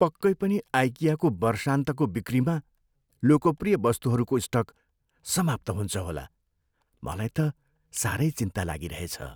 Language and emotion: Nepali, fearful